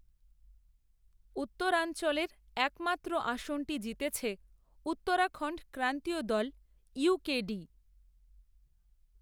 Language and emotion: Bengali, neutral